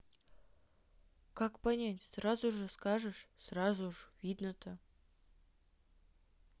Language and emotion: Russian, neutral